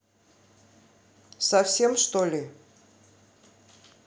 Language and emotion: Russian, angry